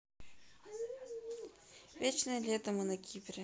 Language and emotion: Russian, neutral